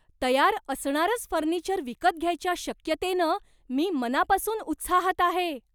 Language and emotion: Marathi, surprised